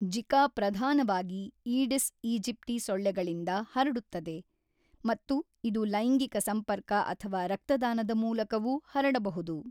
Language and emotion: Kannada, neutral